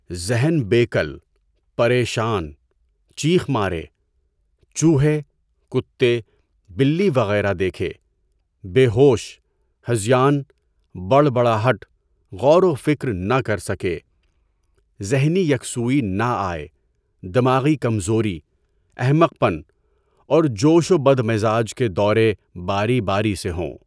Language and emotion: Urdu, neutral